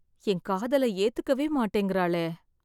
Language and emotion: Tamil, sad